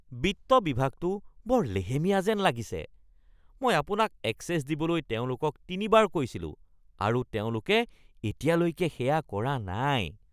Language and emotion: Assamese, disgusted